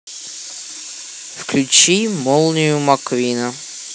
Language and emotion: Russian, neutral